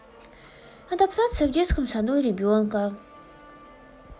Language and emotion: Russian, sad